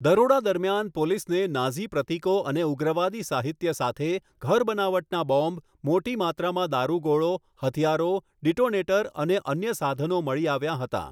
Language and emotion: Gujarati, neutral